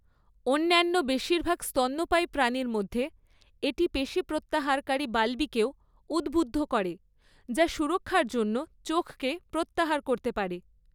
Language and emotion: Bengali, neutral